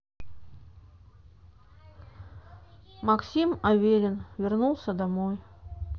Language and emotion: Russian, neutral